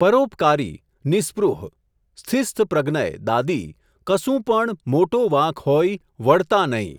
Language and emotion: Gujarati, neutral